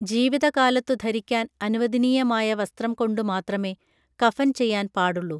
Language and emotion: Malayalam, neutral